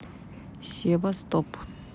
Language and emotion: Russian, neutral